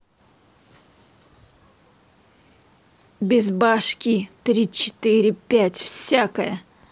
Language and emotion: Russian, neutral